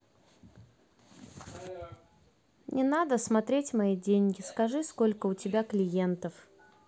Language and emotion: Russian, neutral